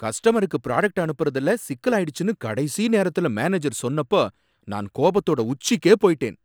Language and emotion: Tamil, angry